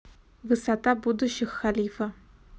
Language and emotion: Russian, neutral